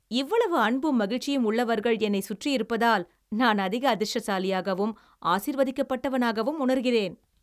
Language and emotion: Tamil, happy